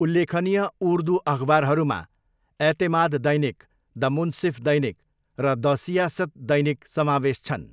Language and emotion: Nepali, neutral